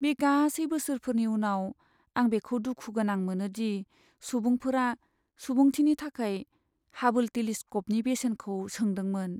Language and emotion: Bodo, sad